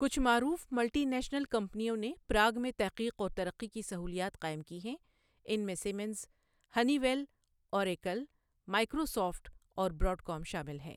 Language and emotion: Urdu, neutral